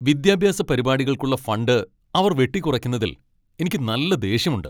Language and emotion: Malayalam, angry